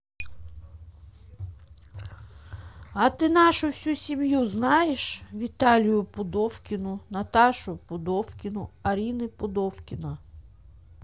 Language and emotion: Russian, neutral